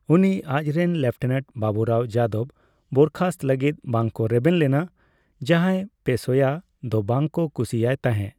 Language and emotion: Santali, neutral